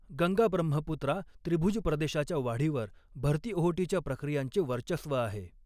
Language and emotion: Marathi, neutral